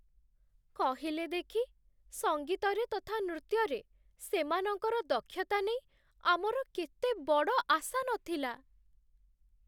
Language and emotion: Odia, sad